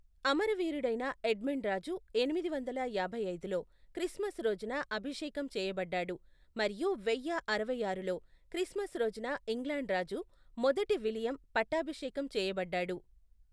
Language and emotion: Telugu, neutral